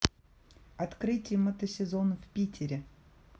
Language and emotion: Russian, neutral